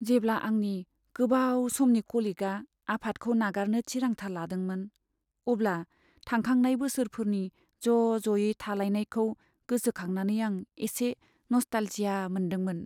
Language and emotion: Bodo, sad